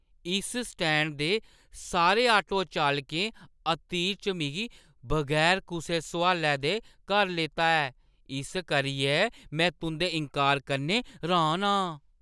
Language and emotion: Dogri, surprised